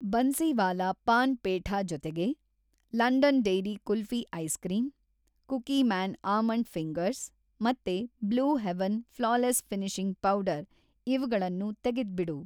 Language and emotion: Kannada, neutral